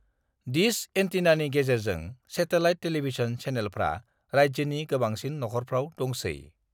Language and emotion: Bodo, neutral